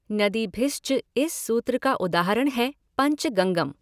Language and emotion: Hindi, neutral